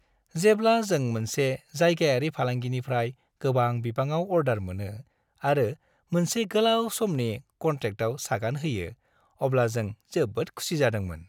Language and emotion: Bodo, happy